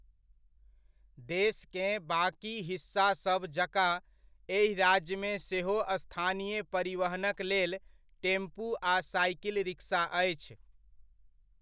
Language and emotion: Maithili, neutral